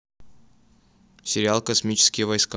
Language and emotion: Russian, neutral